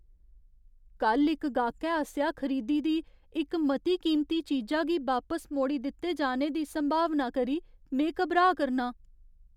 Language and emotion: Dogri, fearful